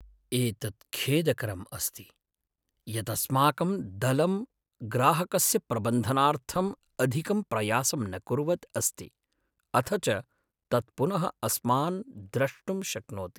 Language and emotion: Sanskrit, sad